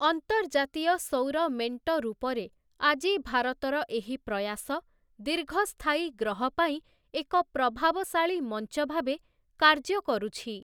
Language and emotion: Odia, neutral